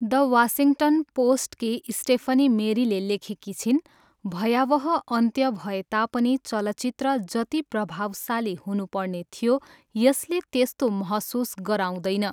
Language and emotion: Nepali, neutral